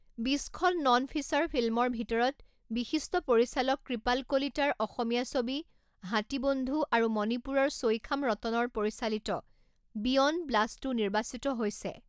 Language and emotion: Assamese, neutral